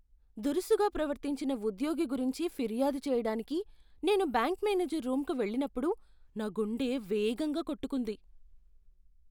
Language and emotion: Telugu, fearful